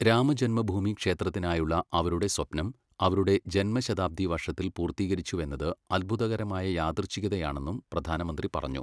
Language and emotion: Malayalam, neutral